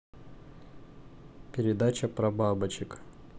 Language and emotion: Russian, neutral